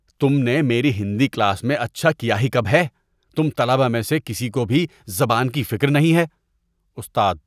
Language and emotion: Urdu, disgusted